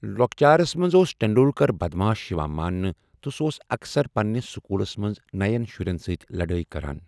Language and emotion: Kashmiri, neutral